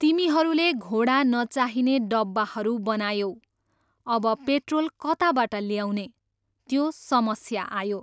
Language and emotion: Nepali, neutral